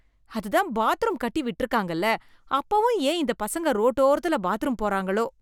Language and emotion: Tamil, disgusted